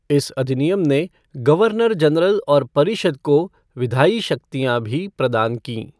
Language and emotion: Hindi, neutral